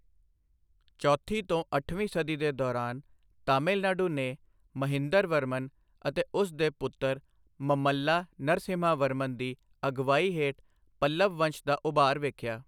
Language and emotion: Punjabi, neutral